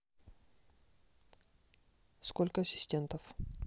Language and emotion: Russian, neutral